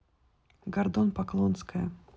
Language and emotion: Russian, neutral